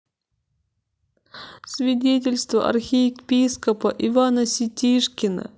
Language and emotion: Russian, sad